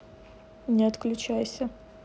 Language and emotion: Russian, neutral